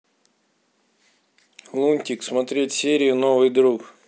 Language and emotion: Russian, neutral